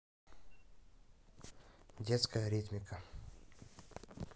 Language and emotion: Russian, neutral